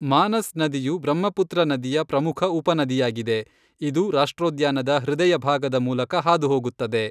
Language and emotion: Kannada, neutral